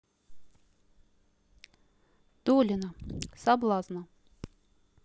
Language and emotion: Russian, neutral